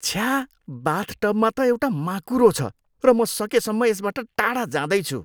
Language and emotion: Nepali, disgusted